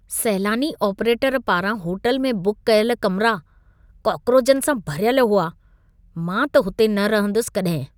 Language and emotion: Sindhi, disgusted